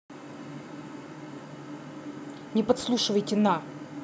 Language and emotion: Russian, angry